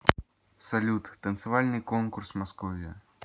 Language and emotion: Russian, neutral